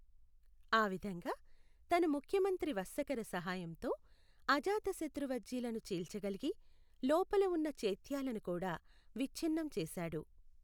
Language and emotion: Telugu, neutral